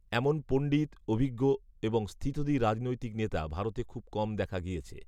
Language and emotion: Bengali, neutral